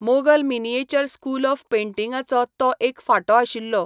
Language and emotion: Goan Konkani, neutral